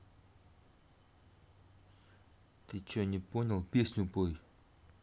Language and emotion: Russian, angry